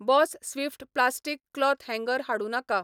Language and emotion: Goan Konkani, neutral